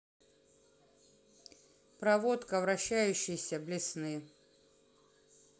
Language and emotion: Russian, neutral